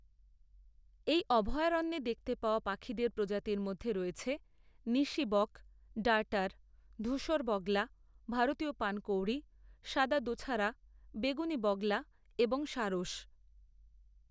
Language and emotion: Bengali, neutral